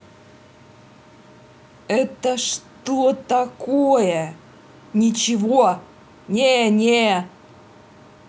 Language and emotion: Russian, angry